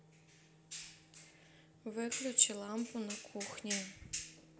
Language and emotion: Russian, neutral